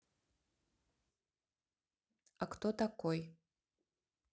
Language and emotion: Russian, neutral